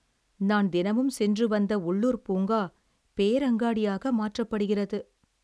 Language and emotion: Tamil, sad